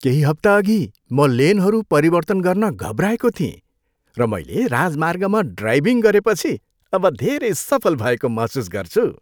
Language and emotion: Nepali, happy